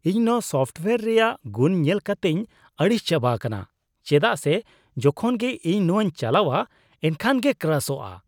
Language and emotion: Santali, disgusted